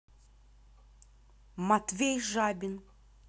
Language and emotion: Russian, neutral